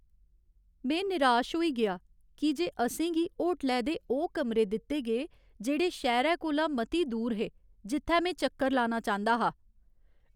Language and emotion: Dogri, sad